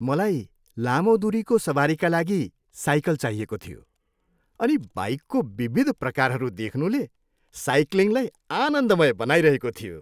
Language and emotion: Nepali, happy